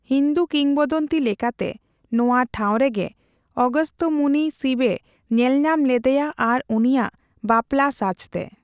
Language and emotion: Santali, neutral